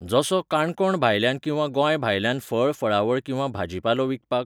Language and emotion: Goan Konkani, neutral